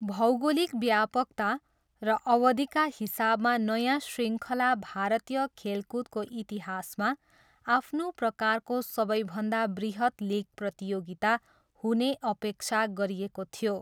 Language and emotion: Nepali, neutral